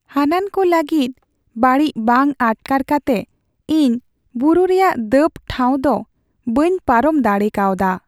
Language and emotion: Santali, sad